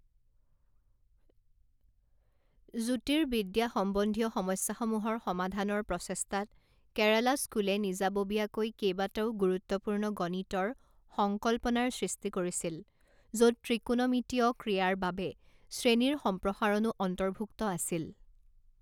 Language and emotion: Assamese, neutral